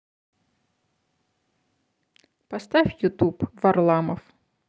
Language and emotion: Russian, neutral